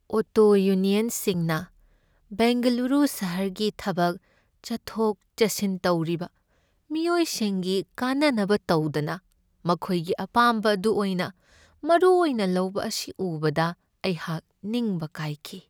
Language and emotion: Manipuri, sad